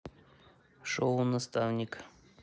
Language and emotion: Russian, neutral